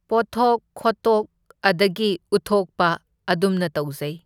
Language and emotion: Manipuri, neutral